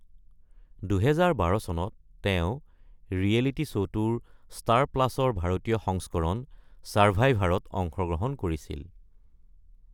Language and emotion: Assamese, neutral